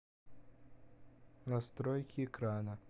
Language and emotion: Russian, neutral